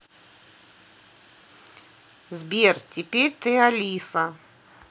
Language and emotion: Russian, neutral